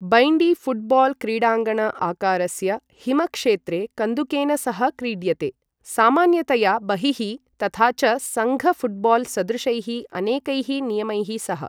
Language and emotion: Sanskrit, neutral